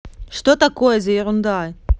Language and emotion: Russian, angry